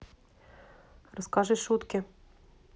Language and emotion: Russian, neutral